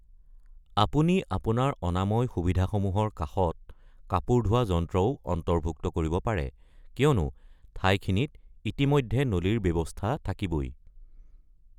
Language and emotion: Assamese, neutral